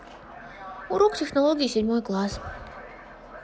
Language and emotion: Russian, neutral